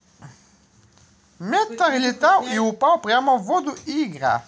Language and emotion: Russian, positive